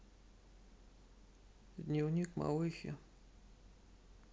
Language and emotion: Russian, neutral